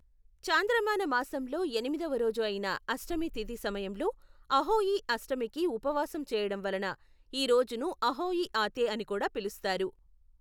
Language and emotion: Telugu, neutral